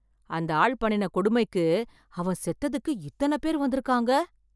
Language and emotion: Tamil, surprised